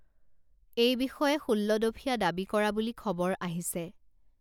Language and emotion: Assamese, neutral